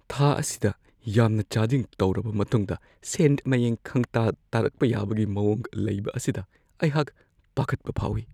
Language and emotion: Manipuri, fearful